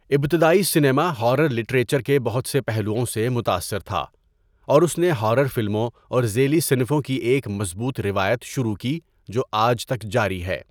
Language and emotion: Urdu, neutral